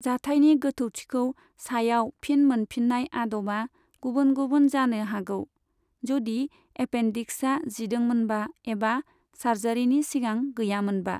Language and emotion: Bodo, neutral